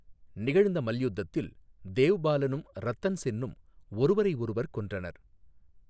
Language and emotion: Tamil, neutral